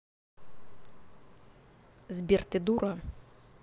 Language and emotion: Russian, angry